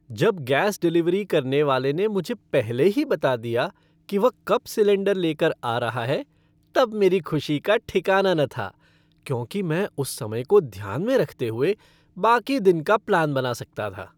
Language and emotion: Hindi, happy